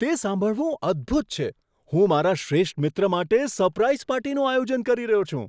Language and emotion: Gujarati, surprised